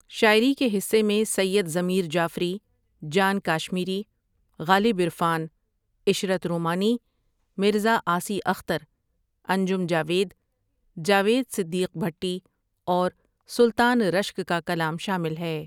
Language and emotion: Urdu, neutral